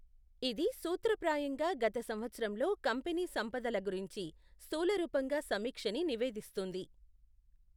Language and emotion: Telugu, neutral